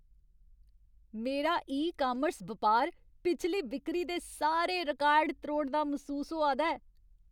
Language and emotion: Dogri, happy